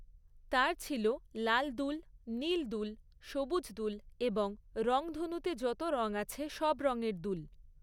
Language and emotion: Bengali, neutral